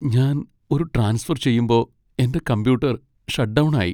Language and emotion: Malayalam, sad